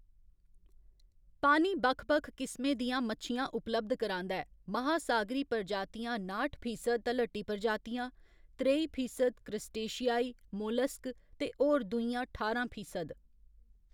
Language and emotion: Dogri, neutral